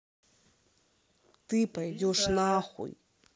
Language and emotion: Russian, angry